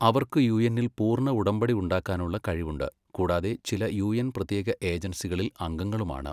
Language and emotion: Malayalam, neutral